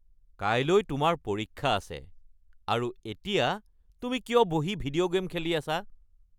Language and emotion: Assamese, angry